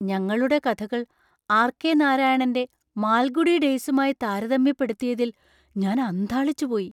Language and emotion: Malayalam, surprised